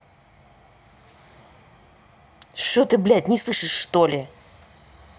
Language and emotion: Russian, angry